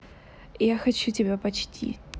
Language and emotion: Russian, neutral